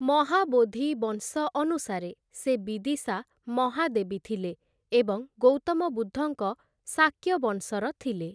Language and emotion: Odia, neutral